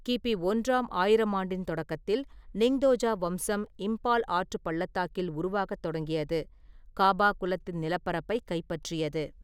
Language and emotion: Tamil, neutral